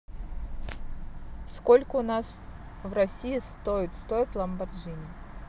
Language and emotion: Russian, neutral